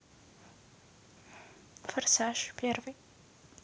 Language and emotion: Russian, neutral